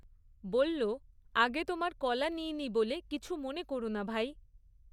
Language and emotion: Bengali, neutral